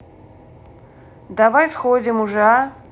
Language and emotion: Russian, neutral